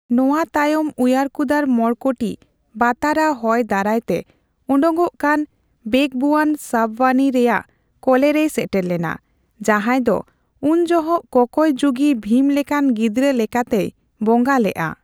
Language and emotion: Santali, neutral